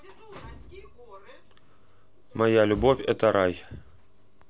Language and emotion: Russian, neutral